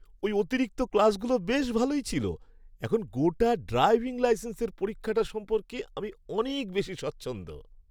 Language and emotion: Bengali, happy